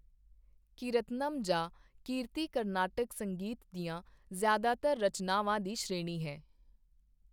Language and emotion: Punjabi, neutral